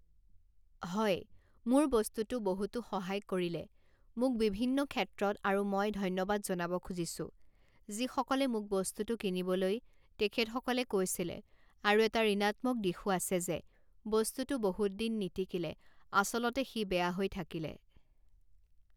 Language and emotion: Assamese, neutral